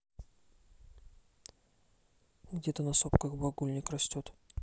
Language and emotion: Russian, neutral